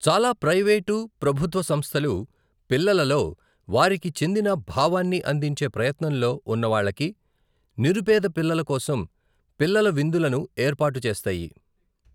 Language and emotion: Telugu, neutral